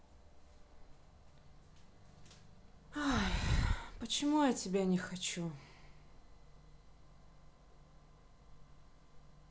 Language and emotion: Russian, sad